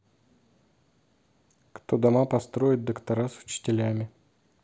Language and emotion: Russian, neutral